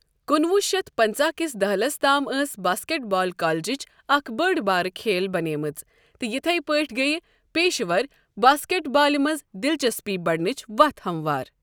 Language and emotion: Kashmiri, neutral